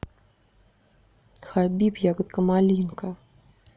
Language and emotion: Russian, neutral